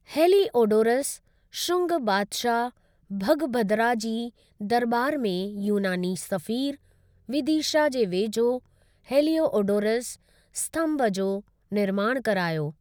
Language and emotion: Sindhi, neutral